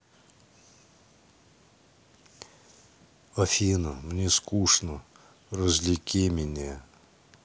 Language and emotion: Russian, sad